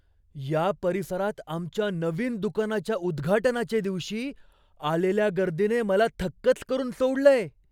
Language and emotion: Marathi, surprised